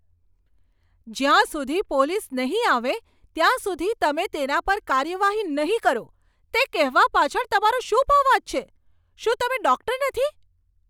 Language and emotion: Gujarati, angry